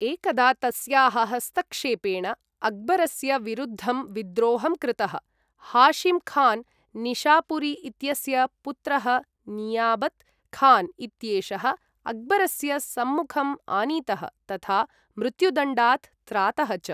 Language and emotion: Sanskrit, neutral